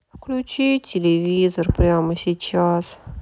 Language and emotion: Russian, sad